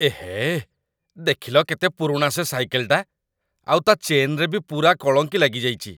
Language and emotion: Odia, disgusted